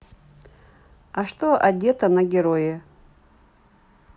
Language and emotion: Russian, neutral